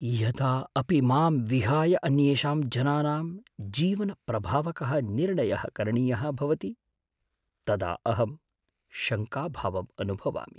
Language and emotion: Sanskrit, fearful